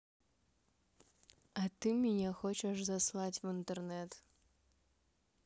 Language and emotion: Russian, neutral